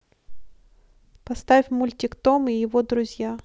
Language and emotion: Russian, neutral